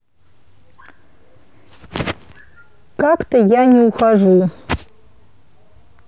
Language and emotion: Russian, neutral